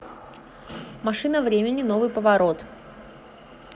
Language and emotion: Russian, neutral